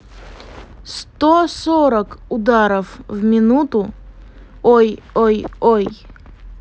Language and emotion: Russian, neutral